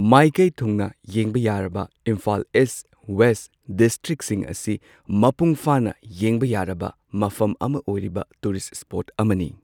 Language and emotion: Manipuri, neutral